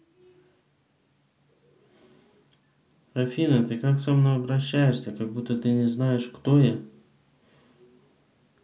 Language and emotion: Russian, neutral